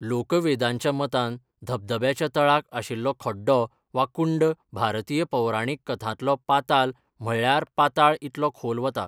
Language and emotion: Goan Konkani, neutral